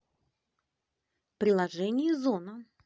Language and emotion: Russian, neutral